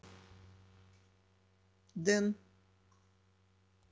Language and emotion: Russian, neutral